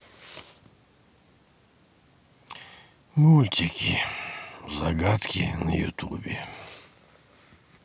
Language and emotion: Russian, sad